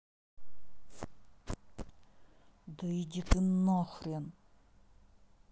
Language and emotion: Russian, angry